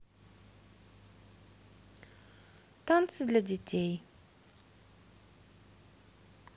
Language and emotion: Russian, sad